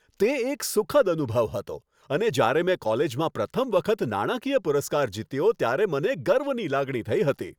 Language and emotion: Gujarati, happy